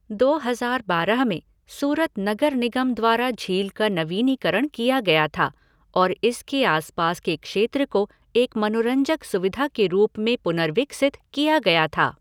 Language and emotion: Hindi, neutral